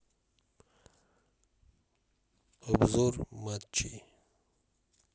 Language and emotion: Russian, neutral